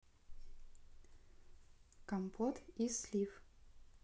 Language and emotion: Russian, neutral